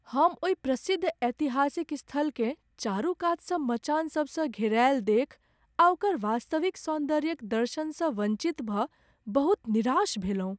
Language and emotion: Maithili, sad